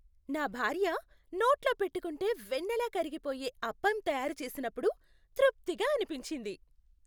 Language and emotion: Telugu, happy